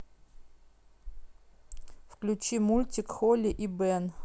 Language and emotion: Russian, neutral